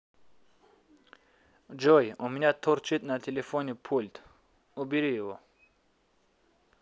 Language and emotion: Russian, neutral